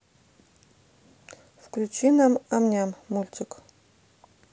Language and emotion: Russian, neutral